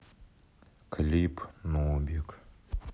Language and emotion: Russian, neutral